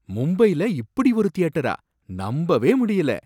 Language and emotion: Tamil, surprised